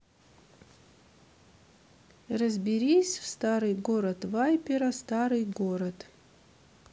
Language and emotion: Russian, neutral